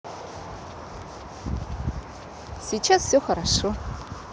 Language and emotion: Russian, positive